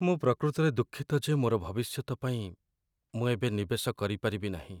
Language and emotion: Odia, sad